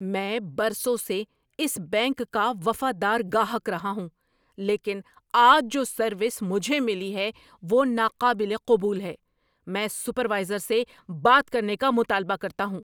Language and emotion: Urdu, angry